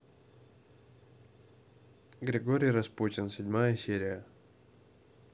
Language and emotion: Russian, neutral